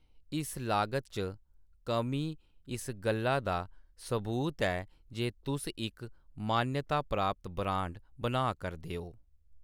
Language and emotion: Dogri, neutral